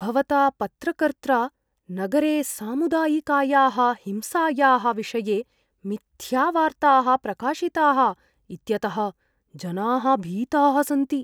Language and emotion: Sanskrit, fearful